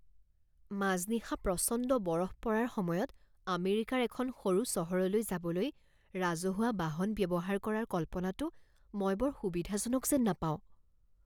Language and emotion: Assamese, fearful